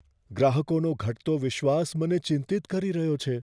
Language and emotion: Gujarati, fearful